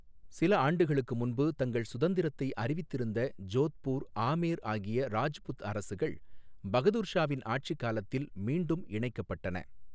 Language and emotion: Tamil, neutral